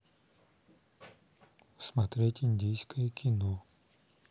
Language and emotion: Russian, neutral